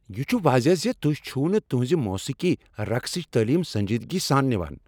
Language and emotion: Kashmiri, angry